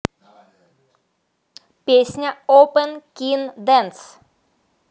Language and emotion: Russian, neutral